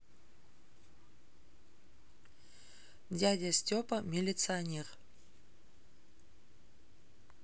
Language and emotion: Russian, neutral